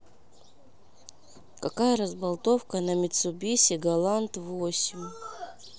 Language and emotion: Russian, neutral